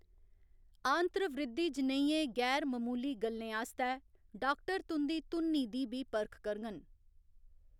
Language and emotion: Dogri, neutral